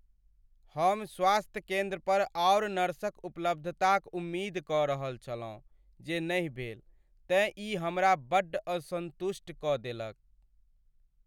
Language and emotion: Maithili, sad